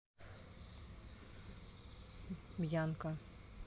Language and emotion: Russian, neutral